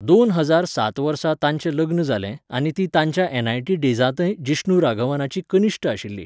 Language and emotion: Goan Konkani, neutral